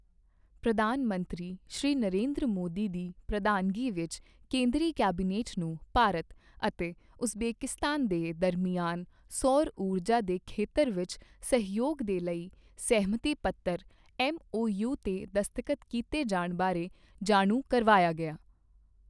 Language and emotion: Punjabi, neutral